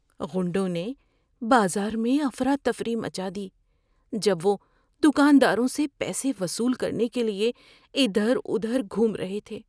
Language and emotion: Urdu, fearful